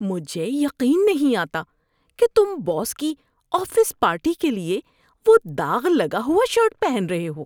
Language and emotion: Urdu, disgusted